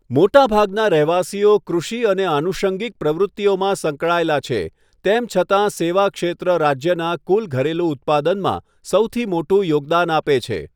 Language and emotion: Gujarati, neutral